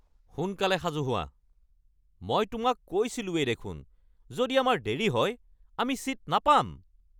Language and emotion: Assamese, angry